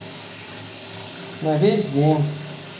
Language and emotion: Russian, neutral